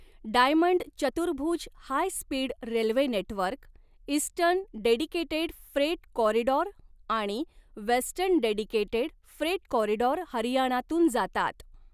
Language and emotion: Marathi, neutral